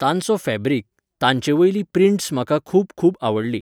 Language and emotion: Goan Konkani, neutral